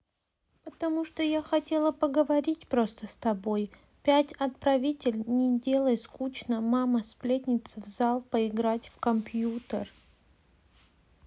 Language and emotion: Russian, sad